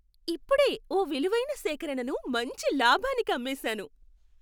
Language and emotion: Telugu, happy